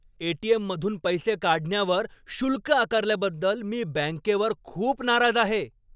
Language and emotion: Marathi, angry